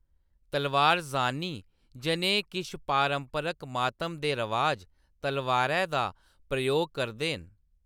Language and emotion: Dogri, neutral